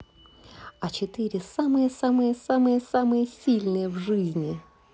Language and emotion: Russian, positive